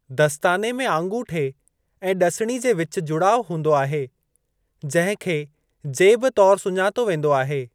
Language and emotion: Sindhi, neutral